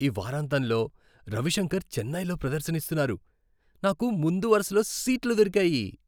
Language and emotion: Telugu, happy